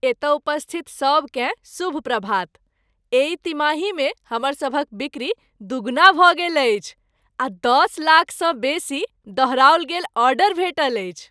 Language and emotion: Maithili, happy